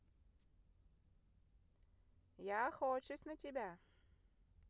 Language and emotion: Russian, positive